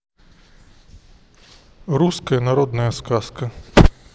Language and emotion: Russian, neutral